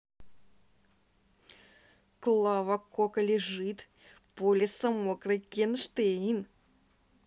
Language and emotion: Russian, angry